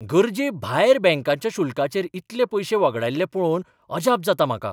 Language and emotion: Goan Konkani, surprised